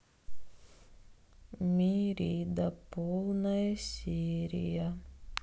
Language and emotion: Russian, sad